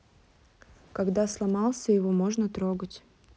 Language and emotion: Russian, neutral